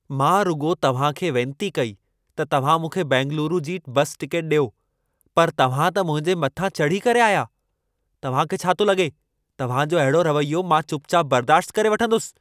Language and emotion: Sindhi, angry